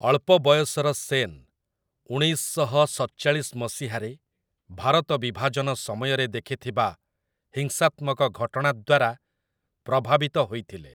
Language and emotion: Odia, neutral